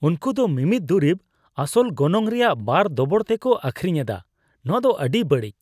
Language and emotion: Santali, disgusted